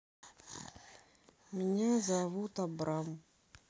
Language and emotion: Russian, sad